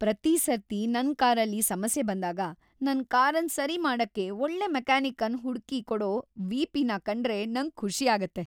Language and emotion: Kannada, happy